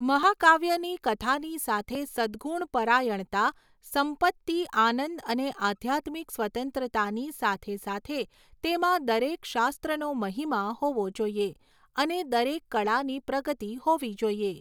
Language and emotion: Gujarati, neutral